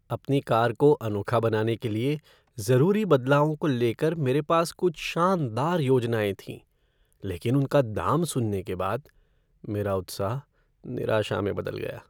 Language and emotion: Hindi, sad